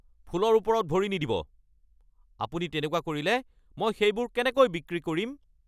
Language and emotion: Assamese, angry